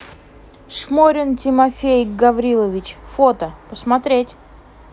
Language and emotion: Russian, neutral